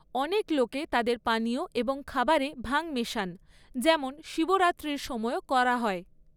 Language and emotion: Bengali, neutral